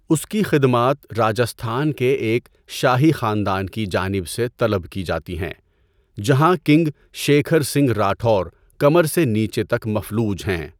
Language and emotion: Urdu, neutral